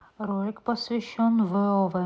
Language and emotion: Russian, neutral